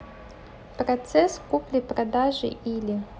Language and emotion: Russian, neutral